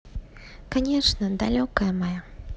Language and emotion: Russian, positive